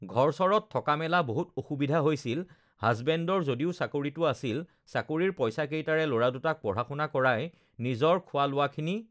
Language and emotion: Assamese, neutral